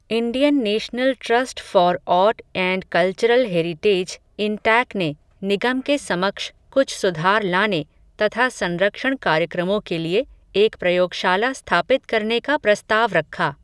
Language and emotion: Hindi, neutral